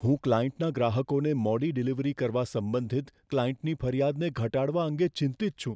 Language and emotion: Gujarati, fearful